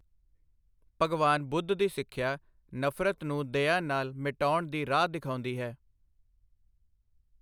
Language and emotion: Punjabi, neutral